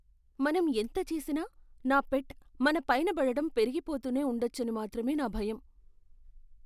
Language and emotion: Telugu, fearful